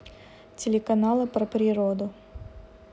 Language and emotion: Russian, neutral